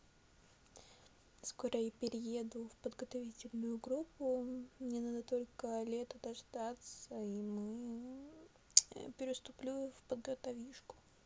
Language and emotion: Russian, neutral